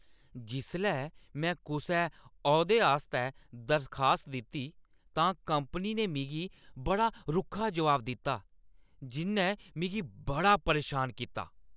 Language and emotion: Dogri, angry